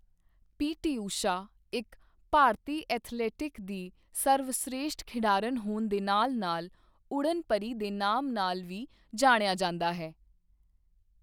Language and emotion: Punjabi, neutral